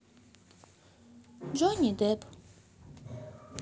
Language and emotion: Russian, neutral